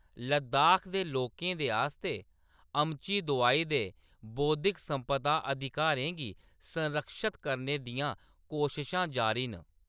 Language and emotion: Dogri, neutral